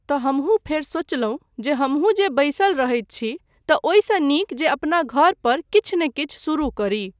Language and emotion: Maithili, neutral